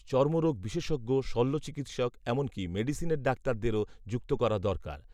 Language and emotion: Bengali, neutral